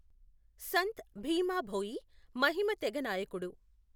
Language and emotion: Telugu, neutral